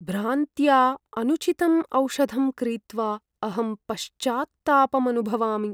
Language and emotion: Sanskrit, sad